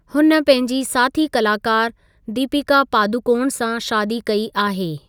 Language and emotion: Sindhi, neutral